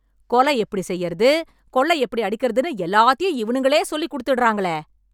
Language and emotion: Tamil, angry